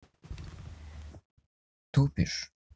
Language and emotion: Russian, neutral